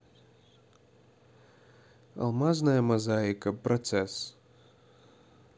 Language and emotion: Russian, neutral